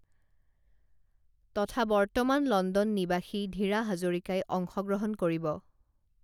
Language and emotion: Assamese, neutral